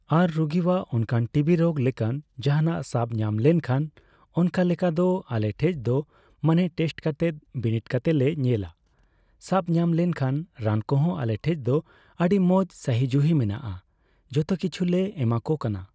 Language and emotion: Santali, neutral